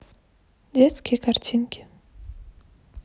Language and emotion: Russian, neutral